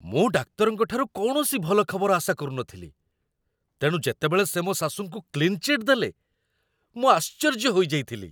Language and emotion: Odia, surprised